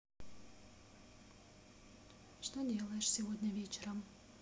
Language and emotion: Russian, sad